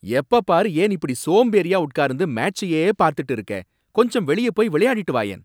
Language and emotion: Tamil, angry